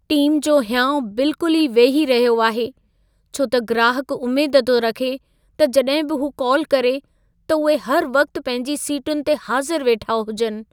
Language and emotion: Sindhi, sad